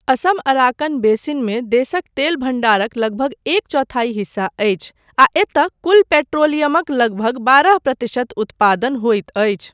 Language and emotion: Maithili, neutral